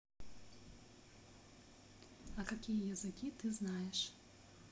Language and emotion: Russian, neutral